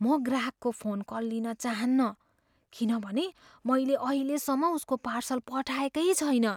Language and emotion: Nepali, fearful